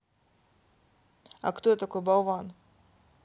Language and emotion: Russian, neutral